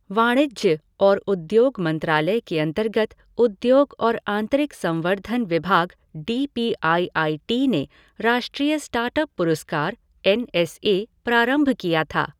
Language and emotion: Hindi, neutral